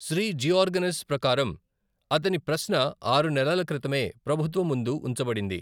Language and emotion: Telugu, neutral